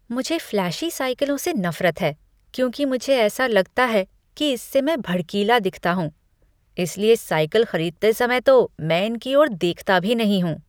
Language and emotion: Hindi, disgusted